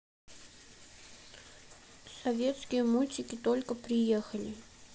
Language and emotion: Russian, sad